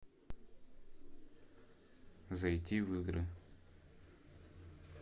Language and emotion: Russian, neutral